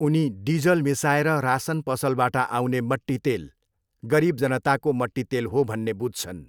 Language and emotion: Nepali, neutral